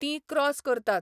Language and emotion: Goan Konkani, neutral